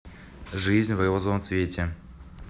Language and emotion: Russian, neutral